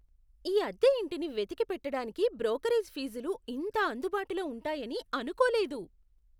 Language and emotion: Telugu, surprised